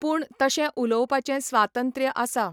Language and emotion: Goan Konkani, neutral